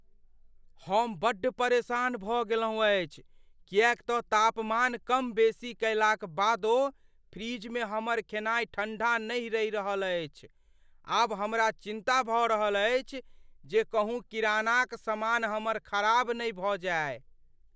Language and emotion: Maithili, fearful